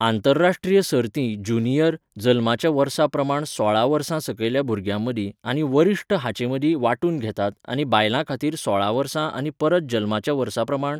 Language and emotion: Goan Konkani, neutral